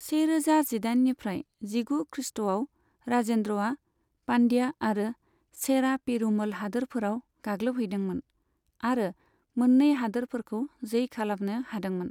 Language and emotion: Bodo, neutral